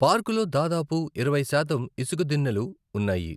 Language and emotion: Telugu, neutral